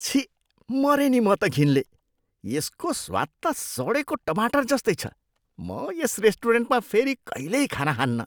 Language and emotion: Nepali, disgusted